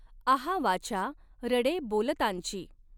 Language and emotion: Marathi, neutral